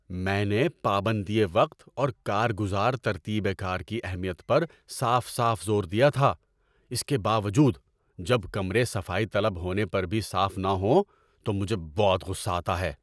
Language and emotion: Urdu, angry